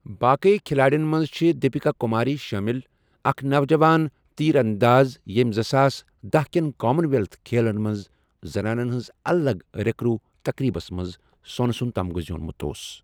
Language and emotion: Kashmiri, neutral